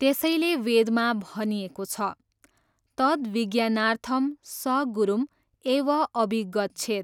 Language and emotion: Nepali, neutral